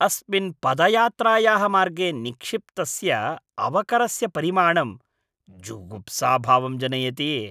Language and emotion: Sanskrit, disgusted